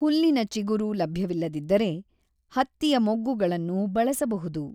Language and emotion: Kannada, neutral